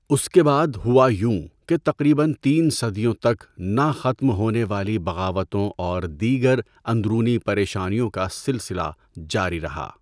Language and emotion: Urdu, neutral